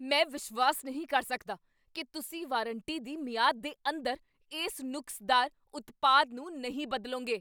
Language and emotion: Punjabi, angry